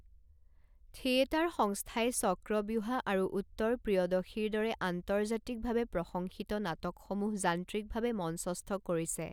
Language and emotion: Assamese, neutral